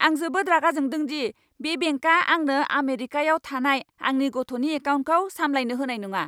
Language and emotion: Bodo, angry